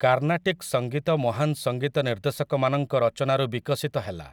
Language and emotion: Odia, neutral